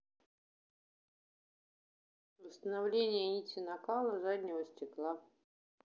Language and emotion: Russian, neutral